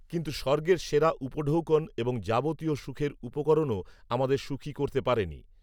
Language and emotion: Bengali, neutral